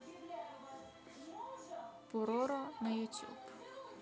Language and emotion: Russian, neutral